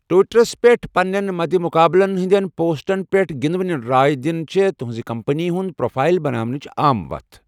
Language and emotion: Kashmiri, neutral